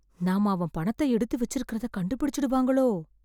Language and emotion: Tamil, fearful